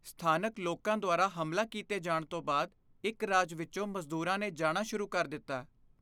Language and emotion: Punjabi, fearful